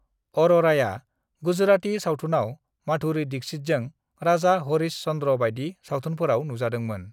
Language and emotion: Bodo, neutral